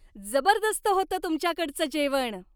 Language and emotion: Marathi, happy